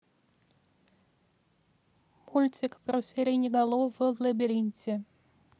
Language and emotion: Russian, neutral